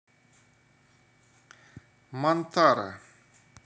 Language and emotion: Russian, neutral